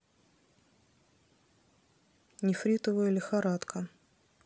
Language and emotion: Russian, neutral